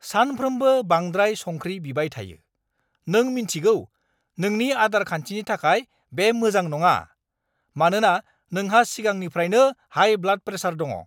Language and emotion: Bodo, angry